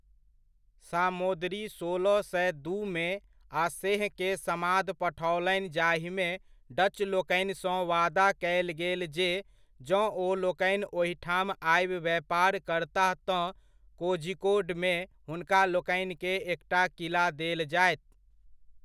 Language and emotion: Maithili, neutral